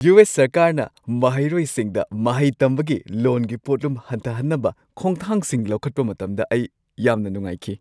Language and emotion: Manipuri, happy